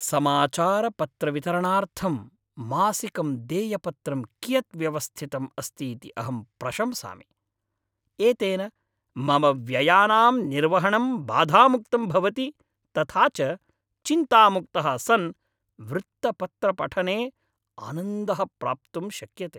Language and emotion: Sanskrit, happy